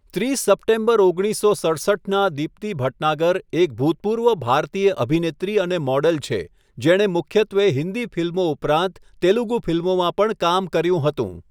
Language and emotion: Gujarati, neutral